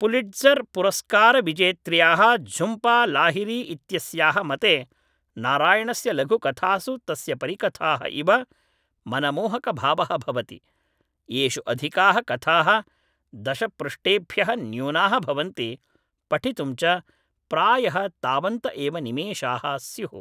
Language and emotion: Sanskrit, neutral